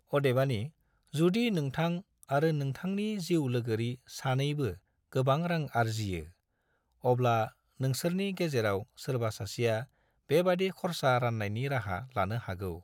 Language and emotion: Bodo, neutral